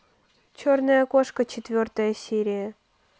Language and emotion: Russian, neutral